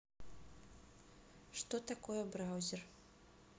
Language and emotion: Russian, neutral